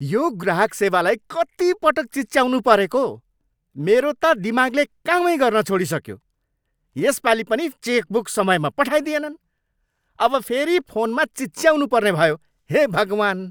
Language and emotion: Nepali, angry